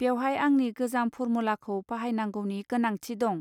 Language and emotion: Bodo, neutral